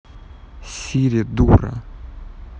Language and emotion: Russian, angry